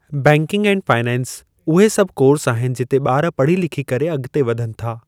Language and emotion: Sindhi, neutral